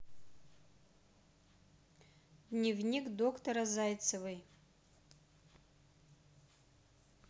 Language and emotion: Russian, neutral